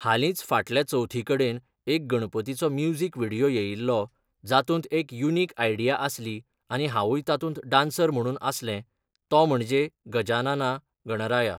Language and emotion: Goan Konkani, neutral